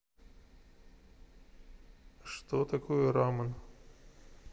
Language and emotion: Russian, neutral